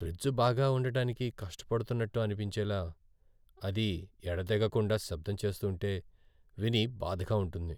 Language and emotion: Telugu, sad